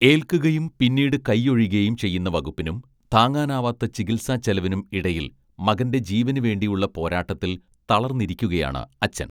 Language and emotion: Malayalam, neutral